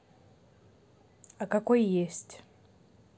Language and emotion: Russian, neutral